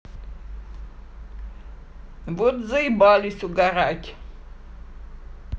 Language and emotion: Russian, neutral